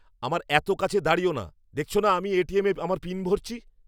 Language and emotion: Bengali, angry